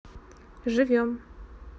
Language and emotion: Russian, neutral